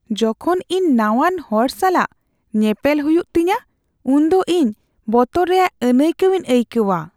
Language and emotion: Santali, fearful